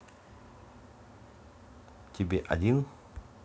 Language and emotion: Russian, neutral